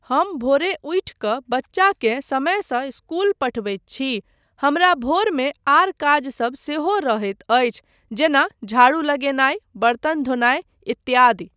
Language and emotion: Maithili, neutral